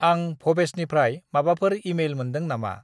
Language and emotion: Bodo, neutral